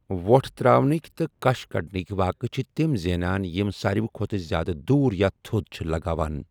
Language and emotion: Kashmiri, neutral